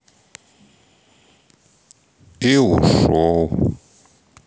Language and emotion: Russian, sad